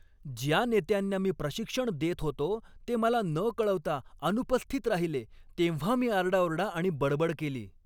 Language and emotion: Marathi, angry